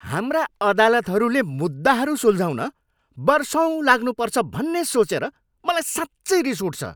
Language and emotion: Nepali, angry